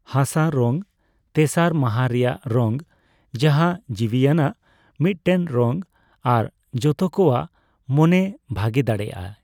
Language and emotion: Santali, neutral